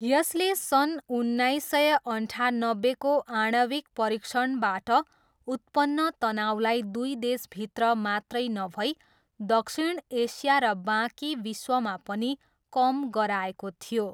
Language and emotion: Nepali, neutral